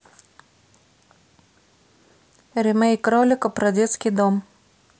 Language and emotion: Russian, neutral